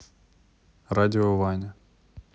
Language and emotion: Russian, neutral